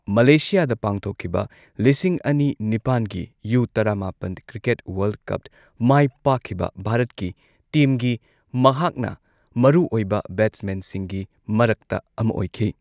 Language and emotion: Manipuri, neutral